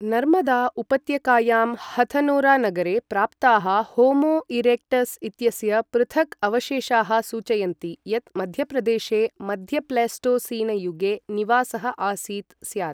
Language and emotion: Sanskrit, neutral